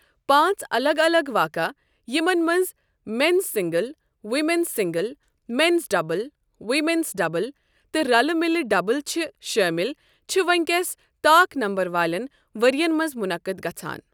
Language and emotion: Kashmiri, neutral